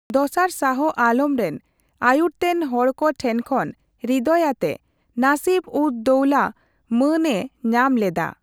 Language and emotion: Santali, neutral